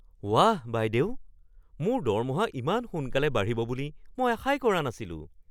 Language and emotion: Assamese, surprised